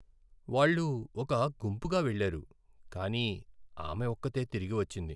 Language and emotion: Telugu, sad